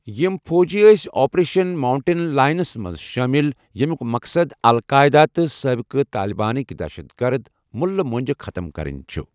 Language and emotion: Kashmiri, neutral